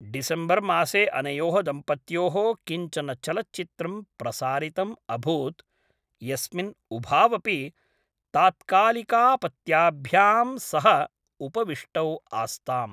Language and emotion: Sanskrit, neutral